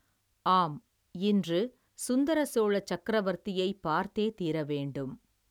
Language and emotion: Tamil, neutral